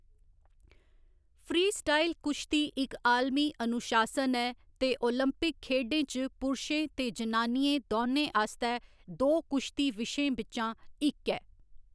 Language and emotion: Dogri, neutral